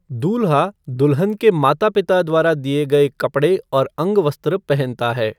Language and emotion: Hindi, neutral